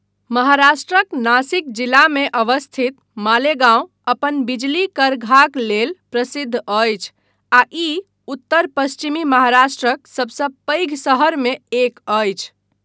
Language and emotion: Maithili, neutral